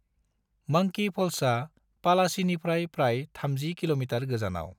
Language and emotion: Bodo, neutral